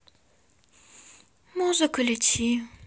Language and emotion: Russian, sad